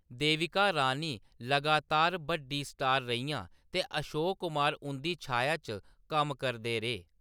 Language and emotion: Dogri, neutral